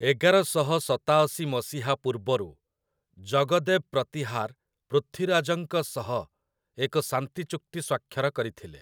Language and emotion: Odia, neutral